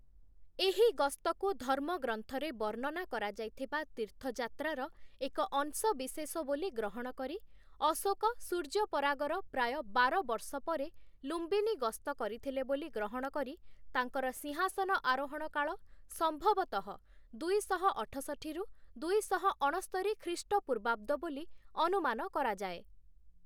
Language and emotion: Odia, neutral